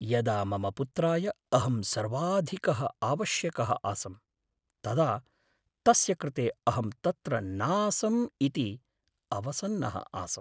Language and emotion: Sanskrit, sad